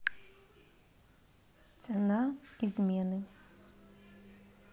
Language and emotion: Russian, neutral